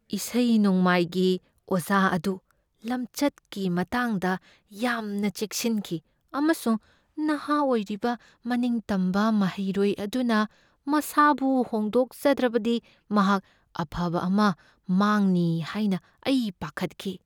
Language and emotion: Manipuri, fearful